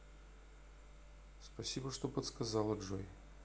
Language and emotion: Russian, neutral